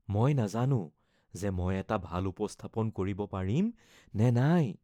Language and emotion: Assamese, fearful